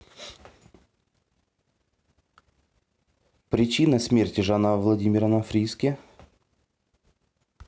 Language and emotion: Russian, neutral